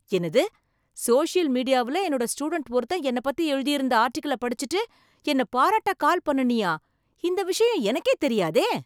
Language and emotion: Tamil, surprised